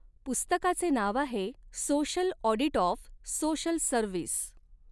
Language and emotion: Marathi, neutral